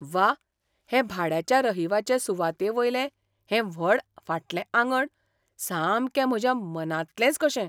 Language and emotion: Goan Konkani, surprised